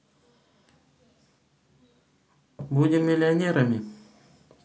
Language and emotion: Russian, neutral